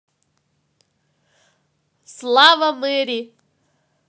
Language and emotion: Russian, positive